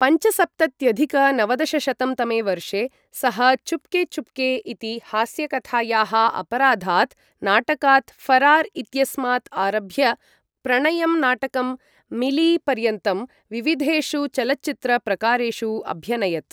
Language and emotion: Sanskrit, neutral